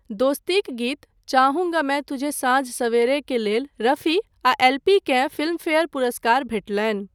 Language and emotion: Maithili, neutral